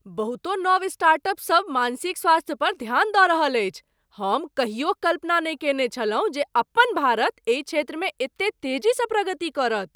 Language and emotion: Maithili, surprised